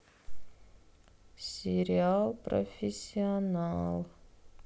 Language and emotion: Russian, sad